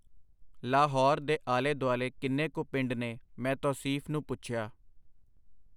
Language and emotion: Punjabi, neutral